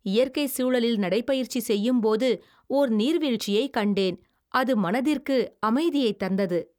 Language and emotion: Tamil, happy